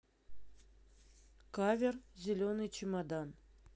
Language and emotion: Russian, neutral